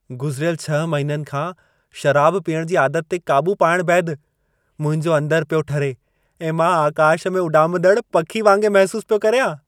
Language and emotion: Sindhi, happy